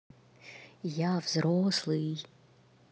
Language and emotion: Russian, neutral